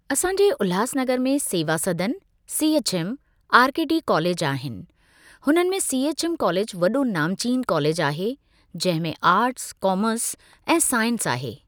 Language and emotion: Sindhi, neutral